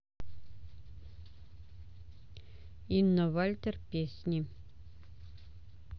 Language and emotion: Russian, neutral